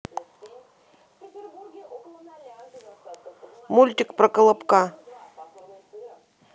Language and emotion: Russian, neutral